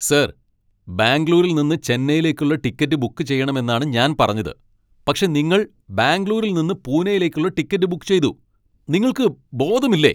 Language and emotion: Malayalam, angry